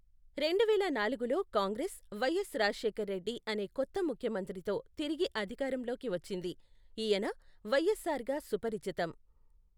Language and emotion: Telugu, neutral